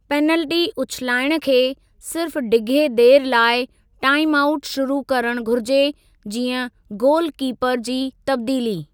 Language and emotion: Sindhi, neutral